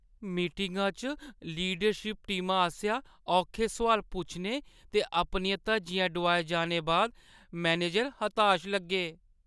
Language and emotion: Dogri, sad